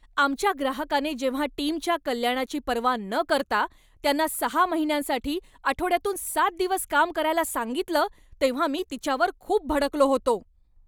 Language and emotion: Marathi, angry